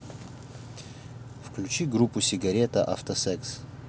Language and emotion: Russian, neutral